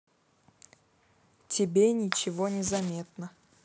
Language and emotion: Russian, neutral